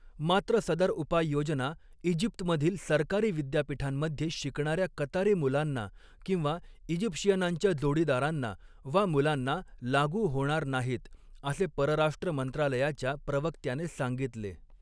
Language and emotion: Marathi, neutral